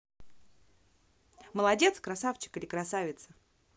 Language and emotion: Russian, positive